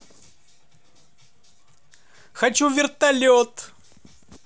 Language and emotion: Russian, positive